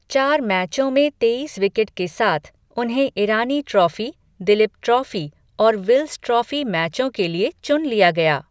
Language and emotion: Hindi, neutral